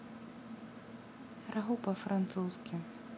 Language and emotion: Russian, neutral